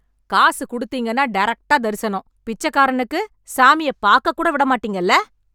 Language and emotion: Tamil, angry